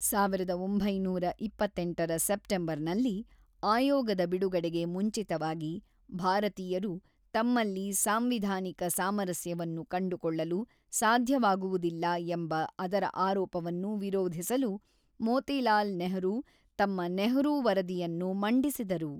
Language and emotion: Kannada, neutral